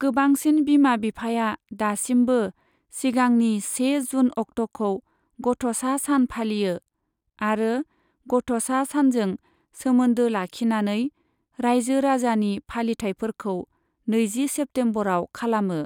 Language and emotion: Bodo, neutral